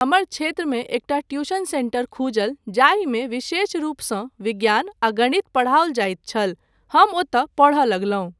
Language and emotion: Maithili, neutral